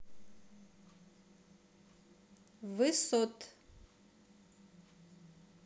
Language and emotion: Russian, neutral